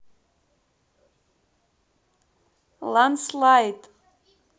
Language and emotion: Russian, neutral